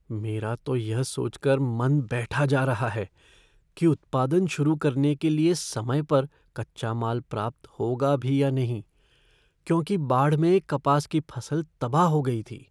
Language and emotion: Hindi, fearful